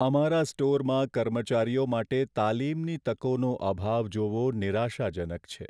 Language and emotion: Gujarati, sad